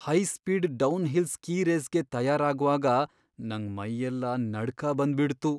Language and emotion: Kannada, fearful